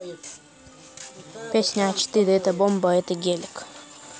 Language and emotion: Russian, neutral